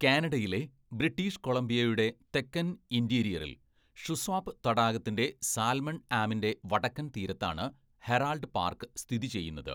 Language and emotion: Malayalam, neutral